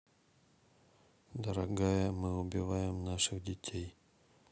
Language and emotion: Russian, neutral